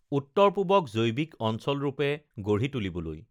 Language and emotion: Assamese, neutral